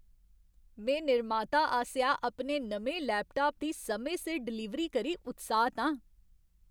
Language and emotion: Dogri, happy